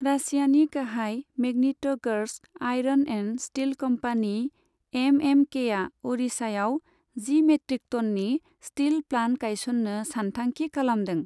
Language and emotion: Bodo, neutral